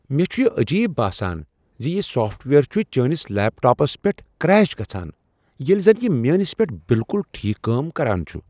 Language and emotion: Kashmiri, surprised